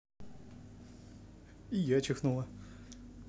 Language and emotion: Russian, neutral